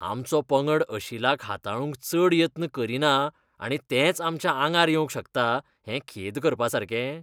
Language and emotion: Goan Konkani, disgusted